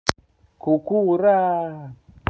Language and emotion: Russian, positive